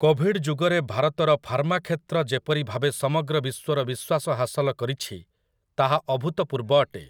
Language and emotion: Odia, neutral